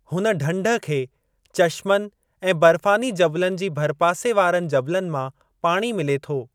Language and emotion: Sindhi, neutral